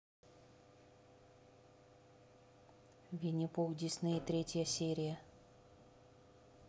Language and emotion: Russian, neutral